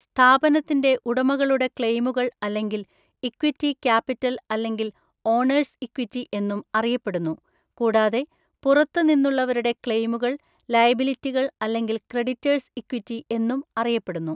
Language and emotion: Malayalam, neutral